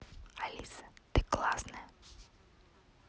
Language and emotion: Russian, neutral